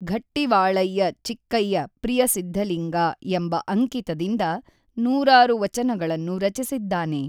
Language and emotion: Kannada, neutral